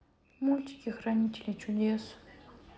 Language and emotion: Russian, sad